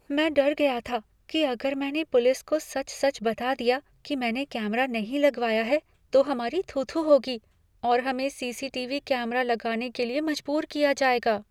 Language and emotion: Hindi, fearful